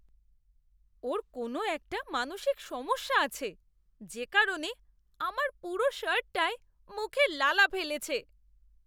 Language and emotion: Bengali, disgusted